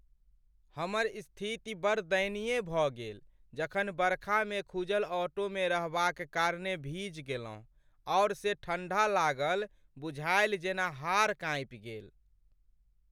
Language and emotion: Maithili, sad